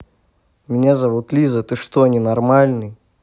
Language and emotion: Russian, neutral